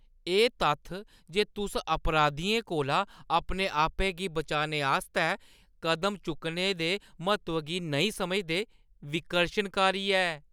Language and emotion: Dogri, disgusted